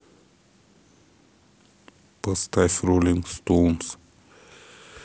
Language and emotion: Russian, neutral